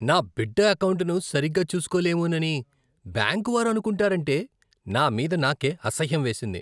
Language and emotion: Telugu, disgusted